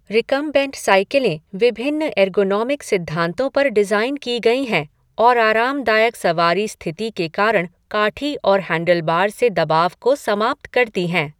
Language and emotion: Hindi, neutral